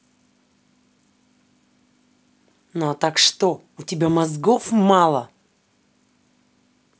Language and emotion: Russian, angry